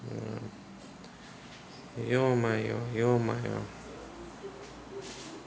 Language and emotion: Russian, sad